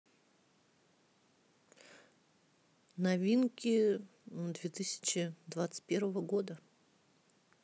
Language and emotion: Russian, neutral